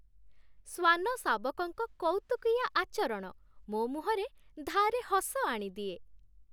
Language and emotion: Odia, happy